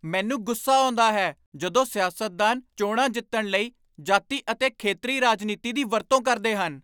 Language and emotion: Punjabi, angry